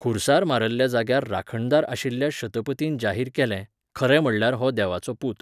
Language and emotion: Goan Konkani, neutral